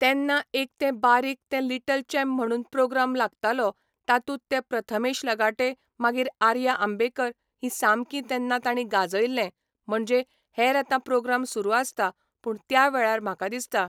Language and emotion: Goan Konkani, neutral